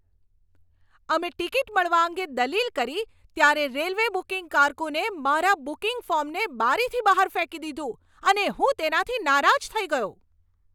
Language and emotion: Gujarati, angry